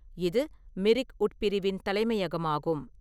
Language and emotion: Tamil, neutral